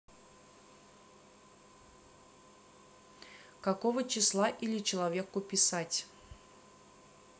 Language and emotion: Russian, neutral